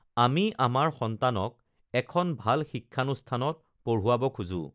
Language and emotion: Assamese, neutral